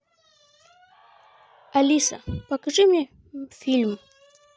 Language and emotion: Russian, neutral